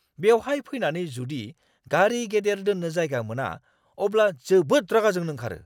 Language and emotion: Bodo, angry